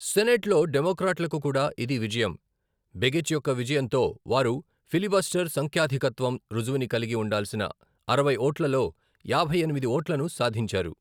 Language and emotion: Telugu, neutral